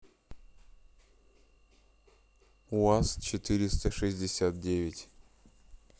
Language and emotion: Russian, neutral